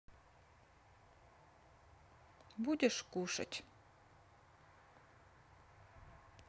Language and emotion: Russian, sad